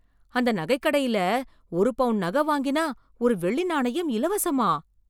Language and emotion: Tamil, surprised